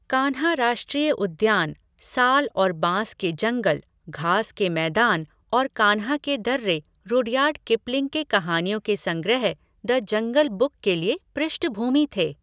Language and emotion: Hindi, neutral